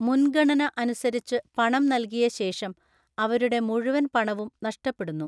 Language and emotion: Malayalam, neutral